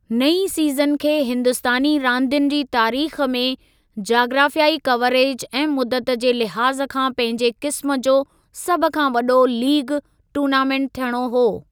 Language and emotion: Sindhi, neutral